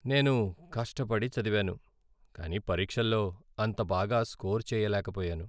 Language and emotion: Telugu, sad